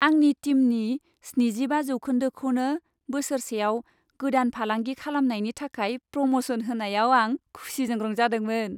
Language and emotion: Bodo, happy